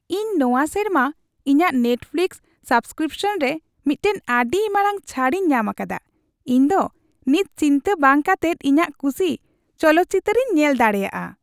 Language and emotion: Santali, happy